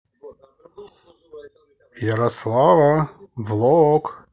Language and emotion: Russian, positive